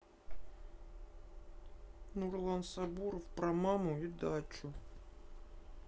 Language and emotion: Russian, sad